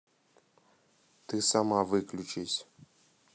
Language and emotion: Russian, neutral